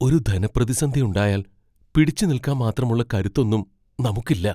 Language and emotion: Malayalam, fearful